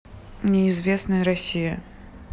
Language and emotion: Russian, neutral